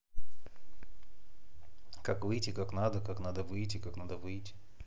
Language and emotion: Russian, neutral